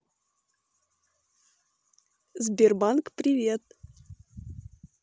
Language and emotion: Russian, positive